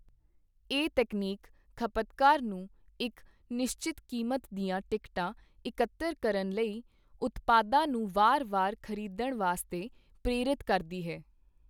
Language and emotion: Punjabi, neutral